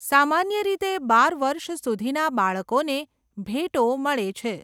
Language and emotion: Gujarati, neutral